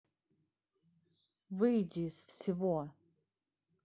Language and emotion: Russian, angry